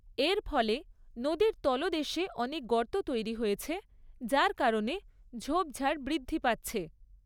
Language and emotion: Bengali, neutral